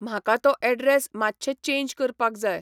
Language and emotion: Goan Konkani, neutral